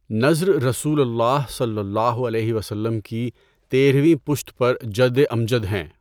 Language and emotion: Urdu, neutral